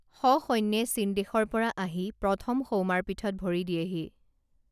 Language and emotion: Assamese, neutral